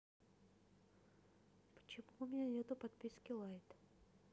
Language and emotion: Russian, neutral